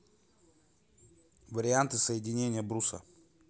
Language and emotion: Russian, neutral